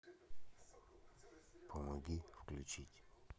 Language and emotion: Russian, neutral